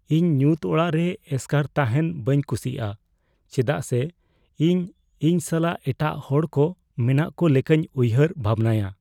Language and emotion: Santali, fearful